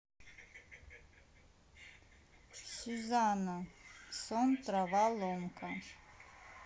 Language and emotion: Russian, neutral